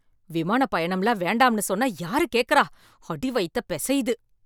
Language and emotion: Tamil, angry